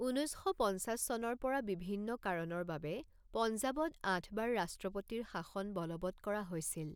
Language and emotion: Assamese, neutral